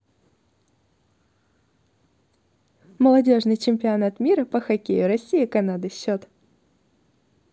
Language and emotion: Russian, positive